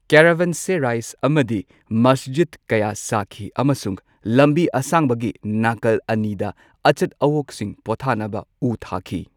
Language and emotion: Manipuri, neutral